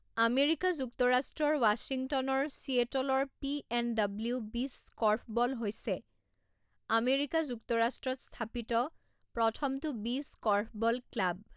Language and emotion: Assamese, neutral